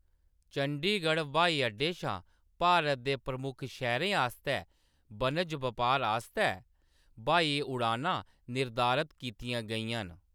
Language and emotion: Dogri, neutral